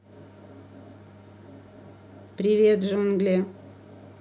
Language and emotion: Russian, neutral